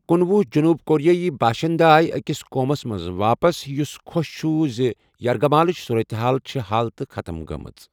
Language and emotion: Kashmiri, neutral